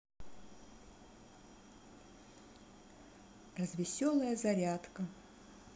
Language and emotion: Russian, neutral